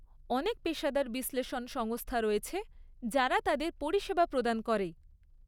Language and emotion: Bengali, neutral